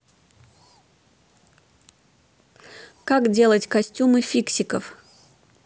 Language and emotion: Russian, neutral